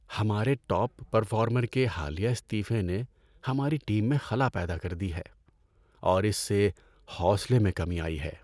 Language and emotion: Urdu, sad